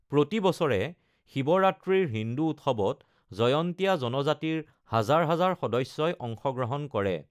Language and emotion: Assamese, neutral